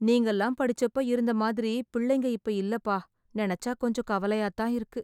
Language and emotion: Tamil, sad